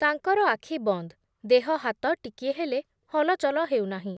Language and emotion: Odia, neutral